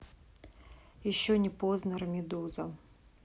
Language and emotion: Russian, neutral